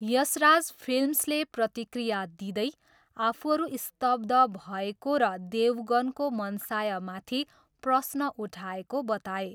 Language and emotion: Nepali, neutral